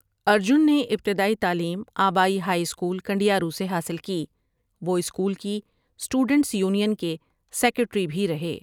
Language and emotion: Urdu, neutral